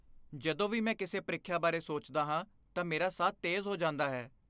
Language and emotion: Punjabi, fearful